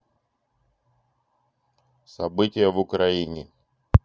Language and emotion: Russian, neutral